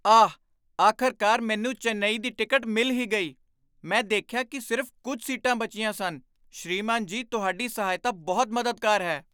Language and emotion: Punjabi, surprised